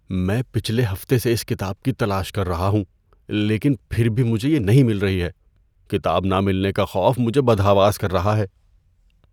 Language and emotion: Urdu, fearful